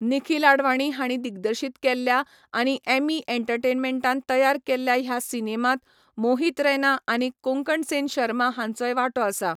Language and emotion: Goan Konkani, neutral